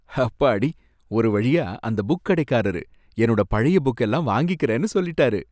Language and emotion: Tamil, happy